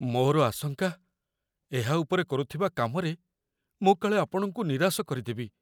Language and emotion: Odia, fearful